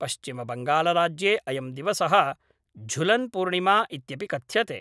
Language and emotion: Sanskrit, neutral